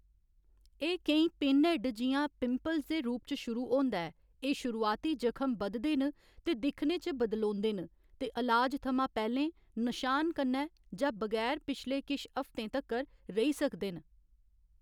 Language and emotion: Dogri, neutral